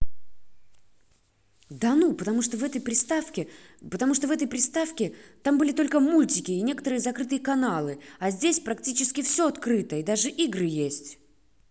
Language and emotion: Russian, angry